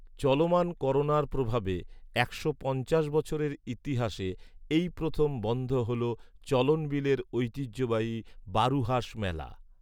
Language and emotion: Bengali, neutral